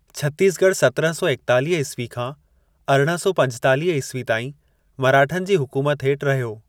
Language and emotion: Sindhi, neutral